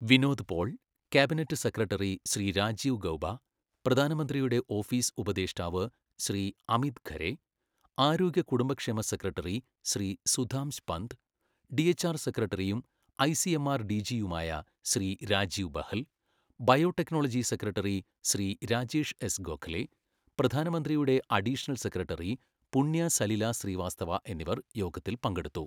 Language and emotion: Malayalam, neutral